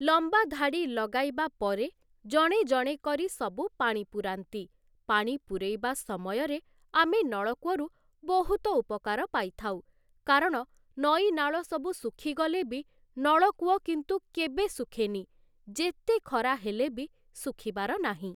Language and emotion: Odia, neutral